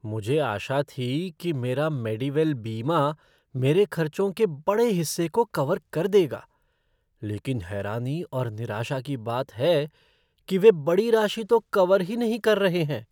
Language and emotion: Hindi, surprised